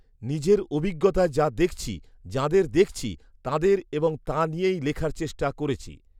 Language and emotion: Bengali, neutral